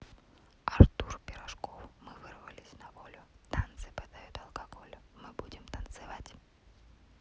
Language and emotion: Russian, neutral